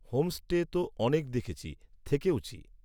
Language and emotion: Bengali, neutral